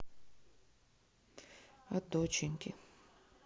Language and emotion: Russian, sad